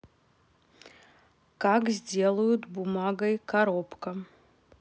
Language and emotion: Russian, neutral